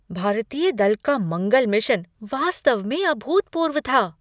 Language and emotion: Hindi, surprised